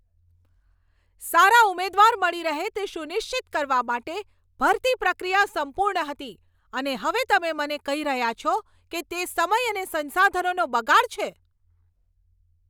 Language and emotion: Gujarati, angry